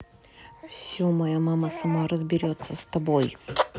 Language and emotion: Russian, angry